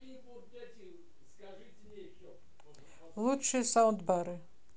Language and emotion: Russian, neutral